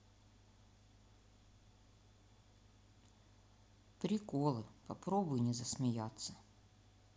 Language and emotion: Russian, sad